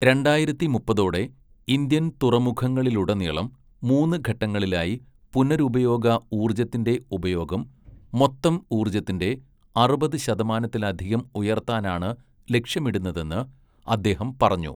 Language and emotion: Malayalam, neutral